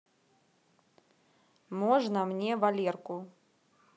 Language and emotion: Russian, neutral